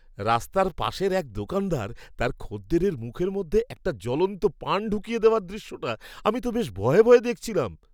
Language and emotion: Bengali, surprised